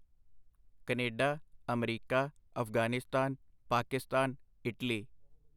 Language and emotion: Punjabi, neutral